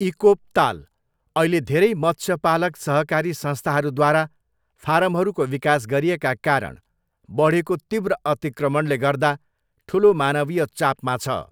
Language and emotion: Nepali, neutral